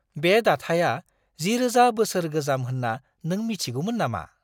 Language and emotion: Bodo, surprised